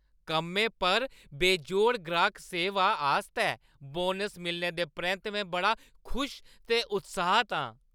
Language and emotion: Dogri, happy